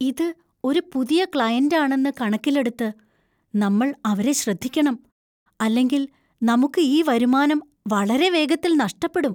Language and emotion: Malayalam, fearful